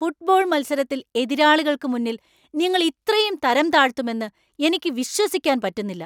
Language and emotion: Malayalam, angry